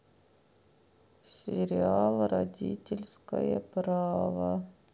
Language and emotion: Russian, sad